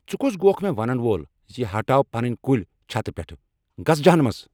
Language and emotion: Kashmiri, angry